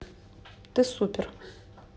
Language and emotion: Russian, neutral